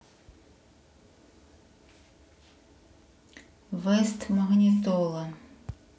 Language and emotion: Russian, neutral